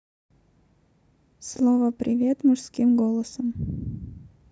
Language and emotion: Russian, neutral